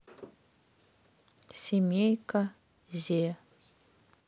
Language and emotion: Russian, neutral